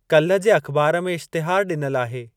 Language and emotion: Sindhi, neutral